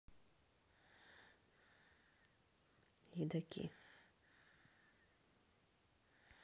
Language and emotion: Russian, neutral